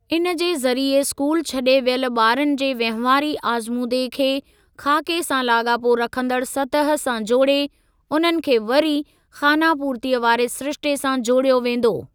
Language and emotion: Sindhi, neutral